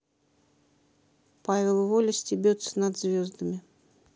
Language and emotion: Russian, neutral